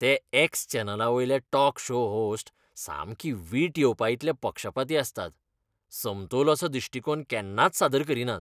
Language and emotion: Goan Konkani, disgusted